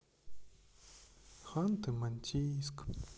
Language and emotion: Russian, sad